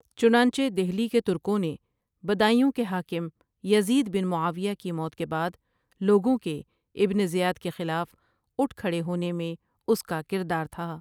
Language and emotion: Urdu, neutral